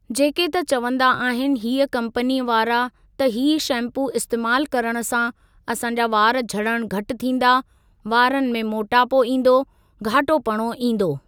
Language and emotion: Sindhi, neutral